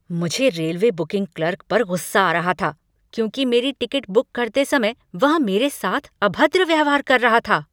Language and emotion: Hindi, angry